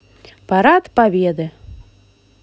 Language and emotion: Russian, positive